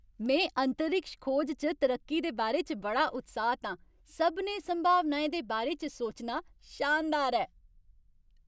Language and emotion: Dogri, happy